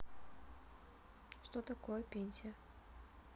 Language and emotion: Russian, neutral